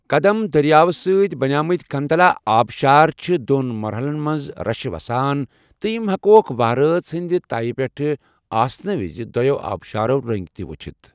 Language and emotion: Kashmiri, neutral